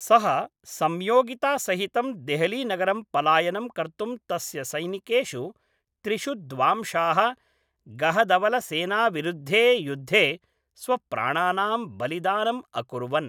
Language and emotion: Sanskrit, neutral